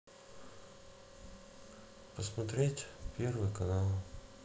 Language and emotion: Russian, neutral